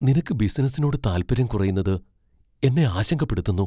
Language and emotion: Malayalam, fearful